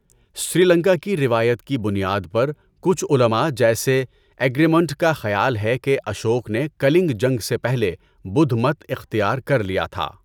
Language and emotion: Urdu, neutral